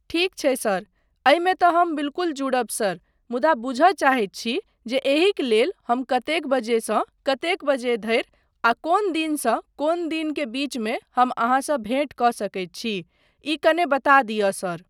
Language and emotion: Maithili, neutral